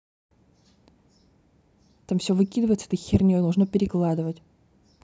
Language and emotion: Russian, angry